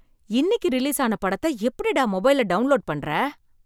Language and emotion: Tamil, surprised